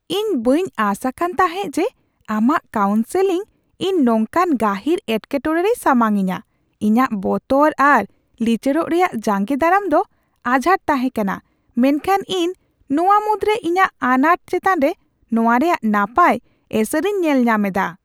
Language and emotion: Santali, surprised